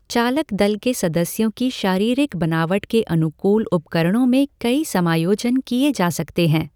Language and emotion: Hindi, neutral